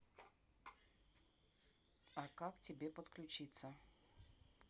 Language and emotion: Russian, neutral